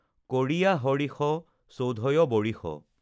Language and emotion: Assamese, neutral